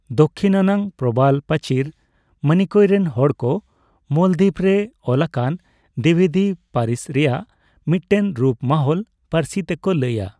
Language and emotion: Santali, neutral